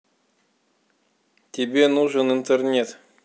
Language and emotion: Russian, neutral